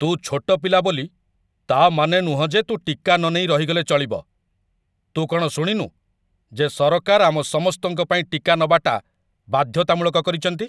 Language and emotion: Odia, angry